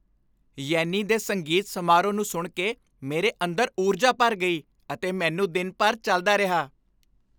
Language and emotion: Punjabi, happy